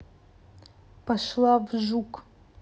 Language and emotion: Russian, angry